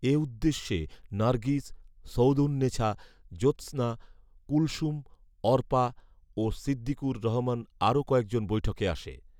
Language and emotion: Bengali, neutral